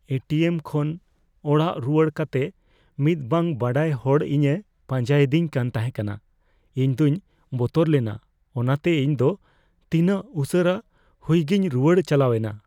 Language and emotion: Santali, fearful